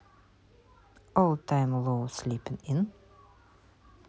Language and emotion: Russian, neutral